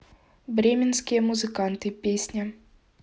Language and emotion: Russian, neutral